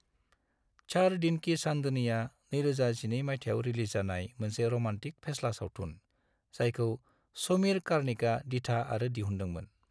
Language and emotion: Bodo, neutral